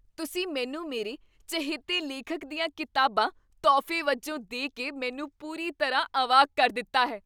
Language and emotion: Punjabi, surprised